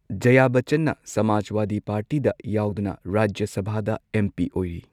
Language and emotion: Manipuri, neutral